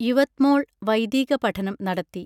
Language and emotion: Malayalam, neutral